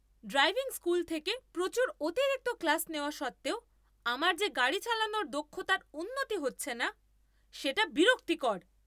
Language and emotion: Bengali, angry